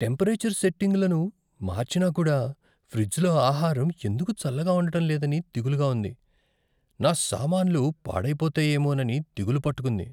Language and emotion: Telugu, fearful